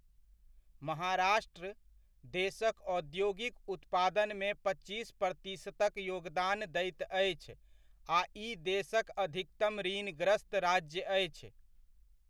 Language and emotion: Maithili, neutral